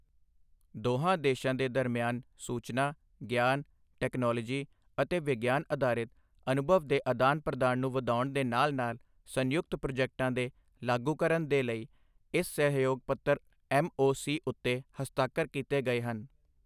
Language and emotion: Punjabi, neutral